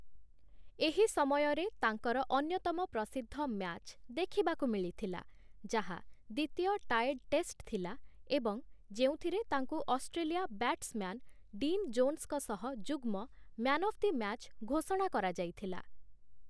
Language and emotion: Odia, neutral